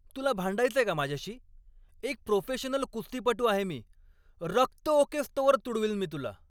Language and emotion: Marathi, angry